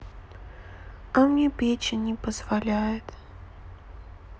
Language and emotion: Russian, sad